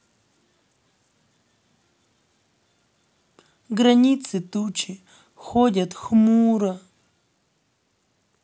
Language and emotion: Russian, sad